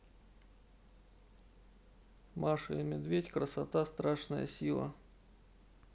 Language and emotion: Russian, neutral